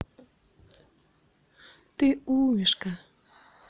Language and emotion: Russian, positive